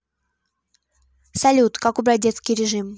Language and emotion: Russian, neutral